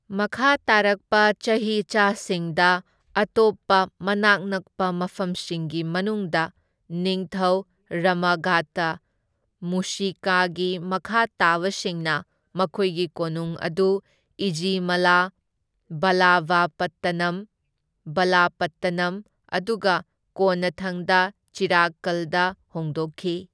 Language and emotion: Manipuri, neutral